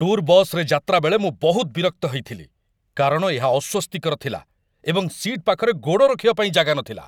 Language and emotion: Odia, angry